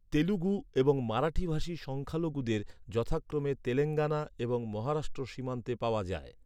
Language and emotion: Bengali, neutral